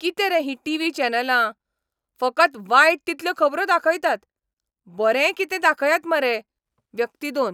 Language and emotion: Goan Konkani, angry